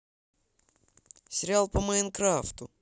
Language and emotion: Russian, positive